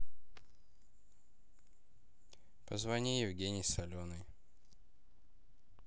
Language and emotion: Russian, neutral